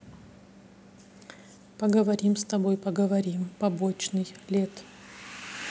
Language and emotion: Russian, neutral